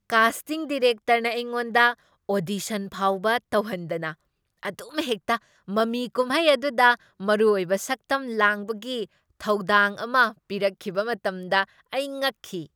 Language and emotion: Manipuri, surprised